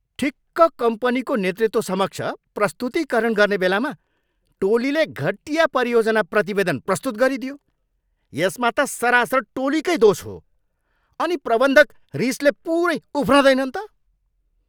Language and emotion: Nepali, angry